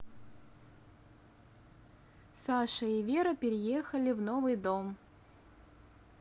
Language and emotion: Russian, neutral